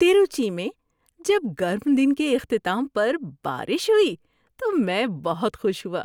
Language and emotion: Urdu, happy